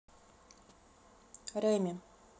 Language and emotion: Russian, neutral